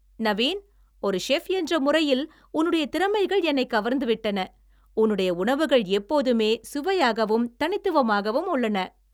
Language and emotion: Tamil, happy